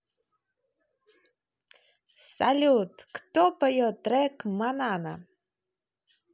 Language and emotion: Russian, positive